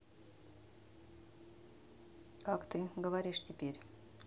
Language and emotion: Russian, neutral